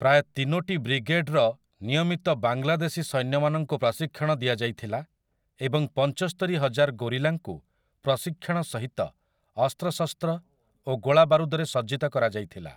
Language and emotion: Odia, neutral